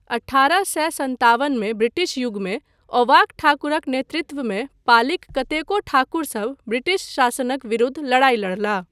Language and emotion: Maithili, neutral